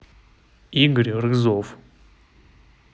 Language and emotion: Russian, neutral